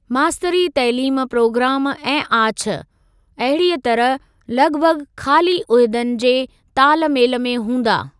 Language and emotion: Sindhi, neutral